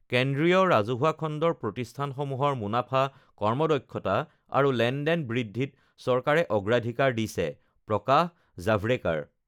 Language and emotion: Assamese, neutral